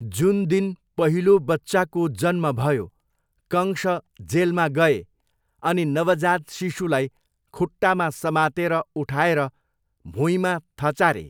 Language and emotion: Nepali, neutral